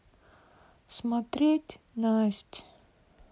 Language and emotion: Russian, sad